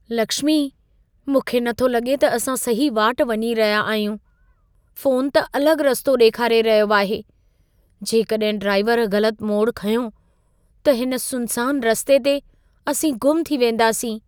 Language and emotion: Sindhi, fearful